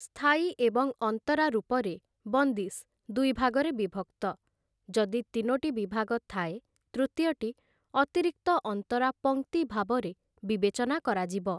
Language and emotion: Odia, neutral